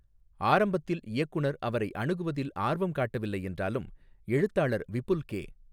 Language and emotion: Tamil, neutral